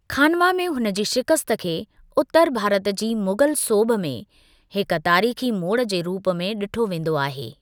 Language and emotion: Sindhi, neutral